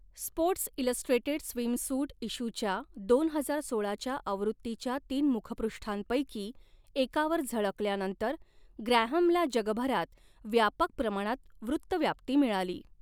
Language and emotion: Marathi, neutral